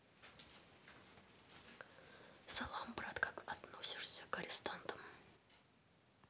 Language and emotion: Russian, neutral